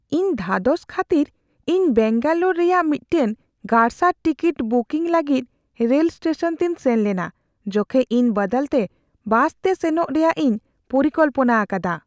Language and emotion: Santali, fearful